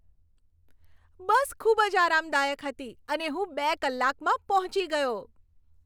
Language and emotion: Gujarati, happy